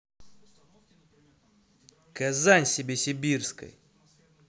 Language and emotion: Russian, angry